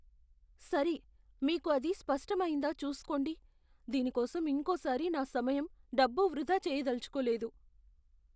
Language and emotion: Telugu, fearful